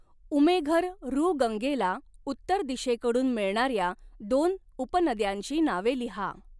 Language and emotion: Marathi, neutral